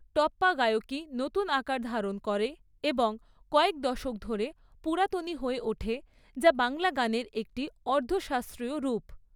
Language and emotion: Bengali, neutral